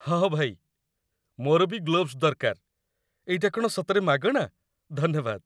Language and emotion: Odia, happy